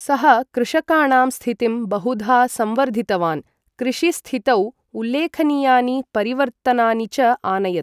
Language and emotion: Sanskrit, neutral